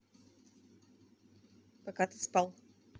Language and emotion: Russian, neutral